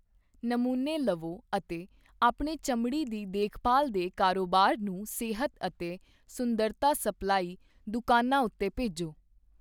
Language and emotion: Punjabi, neutral